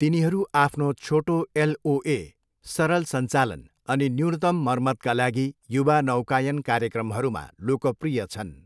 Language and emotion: Nepali, neutral